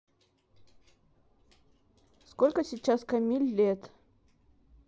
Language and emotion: Russian, neutral